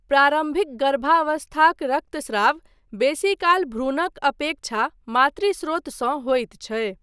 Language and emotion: Maithili, neutral